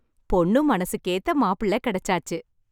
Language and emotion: Tamil, happy